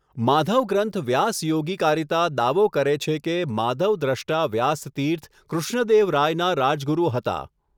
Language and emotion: Gujarati, neutral